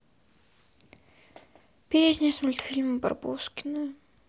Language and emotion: Russian, sad